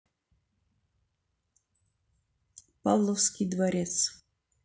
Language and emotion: Russian, neutral